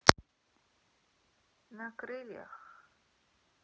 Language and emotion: Russian, sad